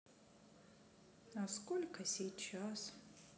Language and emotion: Russian, sad